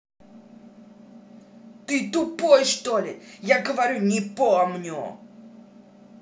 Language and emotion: Russian, angry